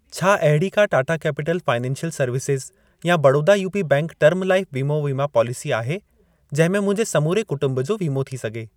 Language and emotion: Sindhi, neutral